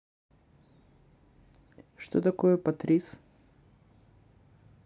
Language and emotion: Russian, neutral